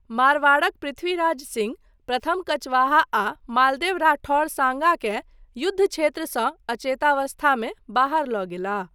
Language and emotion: Maithili, neutral